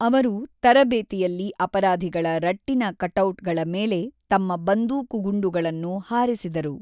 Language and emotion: Kannada, neutral